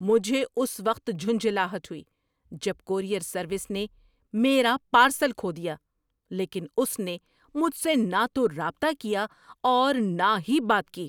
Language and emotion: Urdu, angry